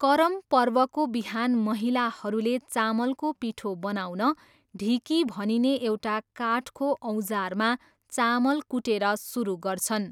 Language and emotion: Nepali, neutral